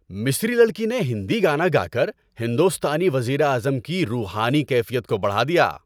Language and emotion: Urdu, happy